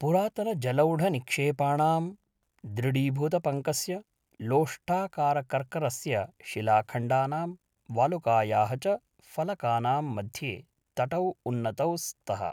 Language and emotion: Sanskrit, neutral